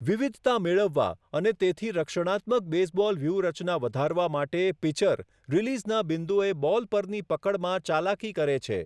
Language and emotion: Gujarati, neutral